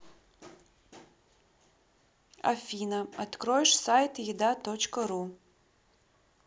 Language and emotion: Russian, neutral